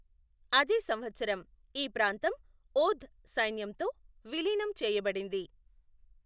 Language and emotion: Telugu, neutral